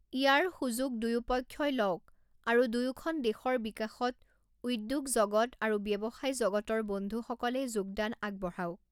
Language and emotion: Assamese, neutral